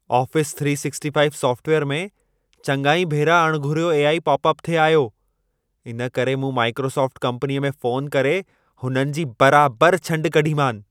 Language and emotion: Sindhi, angry